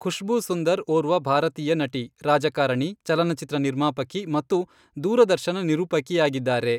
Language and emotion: Kannada, neutral